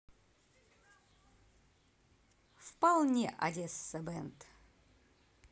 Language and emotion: Russian, positive